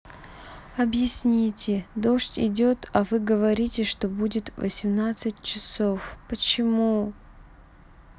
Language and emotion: Russian, sad